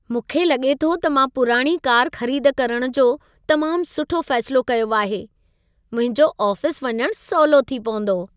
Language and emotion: Sindhi, happy